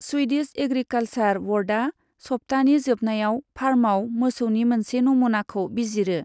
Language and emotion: Bodo, neutral